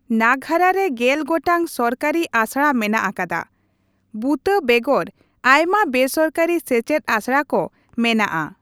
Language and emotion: Santali, neutral